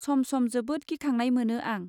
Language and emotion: Bodo, neutral